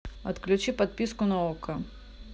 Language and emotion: Russian, neutral